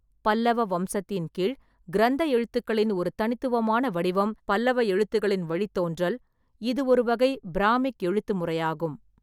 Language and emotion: Tamil, neutral